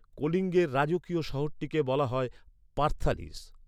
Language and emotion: Bengali, neutral